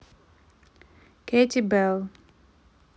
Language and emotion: Russian, neutral